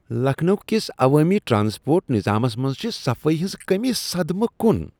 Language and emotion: Kashmiri, disgusted